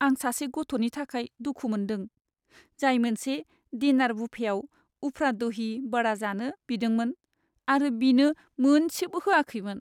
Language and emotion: Bodo, sad